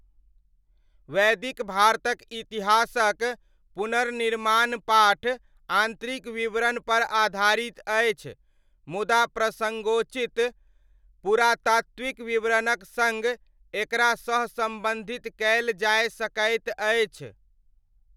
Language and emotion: Maithili, neutral